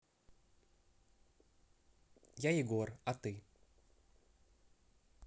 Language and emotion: Russian, neutral